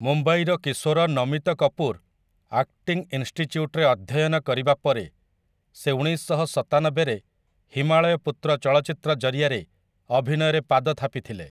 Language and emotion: Odia, neutral